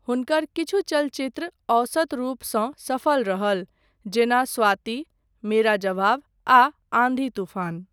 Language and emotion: Maithili, neutral